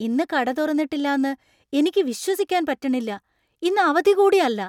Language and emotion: Malayalam, surprised